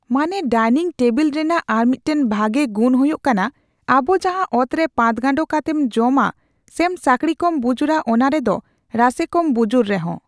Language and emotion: Santali, neutral